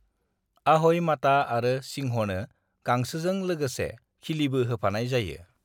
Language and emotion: Bodo, neutral